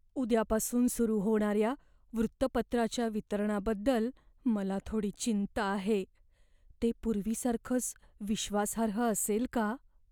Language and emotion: Marathi, fearful